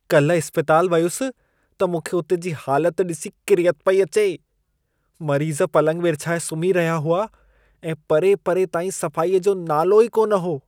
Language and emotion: Sindhi, disgusted